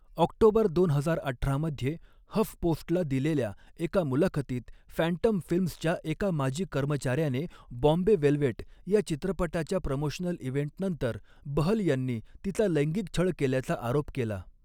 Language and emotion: Marathi, neutral